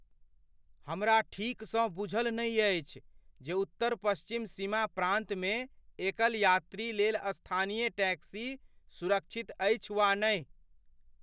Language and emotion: Maithili, fearful